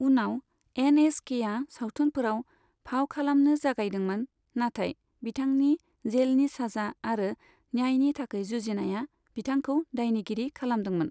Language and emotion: Bodo, neutral